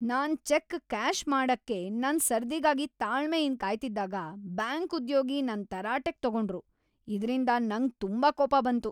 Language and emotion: Kannada, angry